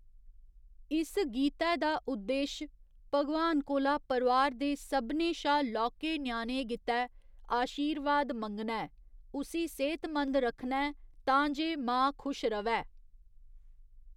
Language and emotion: Dogri, neutral